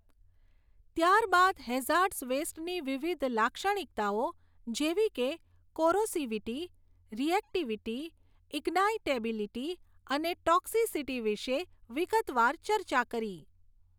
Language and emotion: Gujarati, neutral